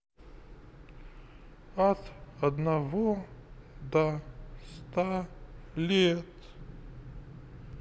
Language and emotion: Russian, sad